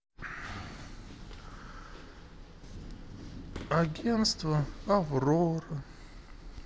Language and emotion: Russian, sad